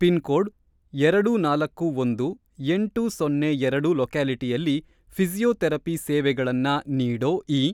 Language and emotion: Kannada, neutral